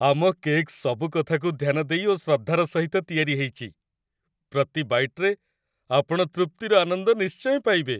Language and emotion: Odia, happy